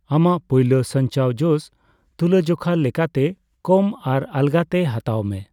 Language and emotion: Santali, neutral